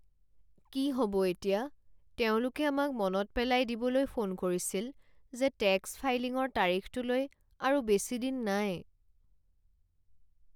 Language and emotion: Assamese, sad